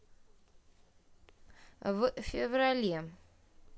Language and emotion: Russian, neutral